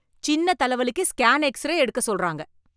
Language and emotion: Tamil, angry